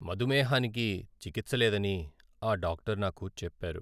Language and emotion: Telugu, sad